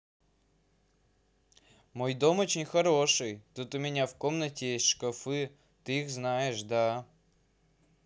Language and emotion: Russian, positive